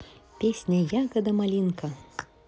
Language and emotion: Russian, positive